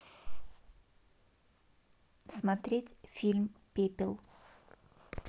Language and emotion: Russian, neutral